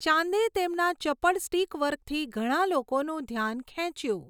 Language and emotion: Gujarati, neutral